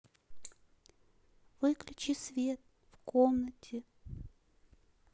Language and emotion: Russian, sad